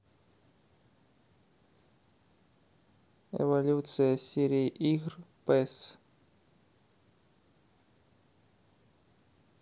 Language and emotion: Russian, neutral